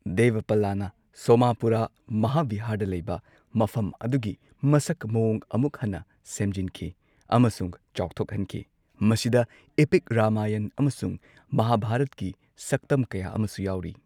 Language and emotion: Manipuri, neutral